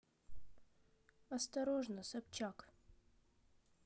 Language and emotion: Russian, neutral